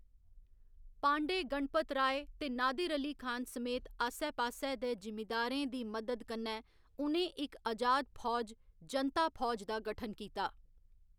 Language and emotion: Dogri, neutral